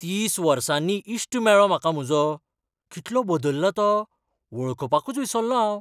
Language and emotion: Goan Konkani, surprised